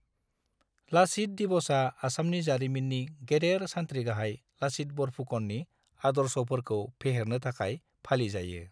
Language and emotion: Bodo, neutral